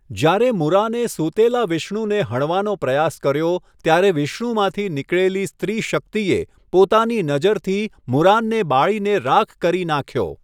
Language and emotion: Gujarati, neutral